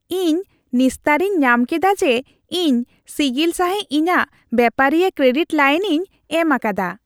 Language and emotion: Santali, happy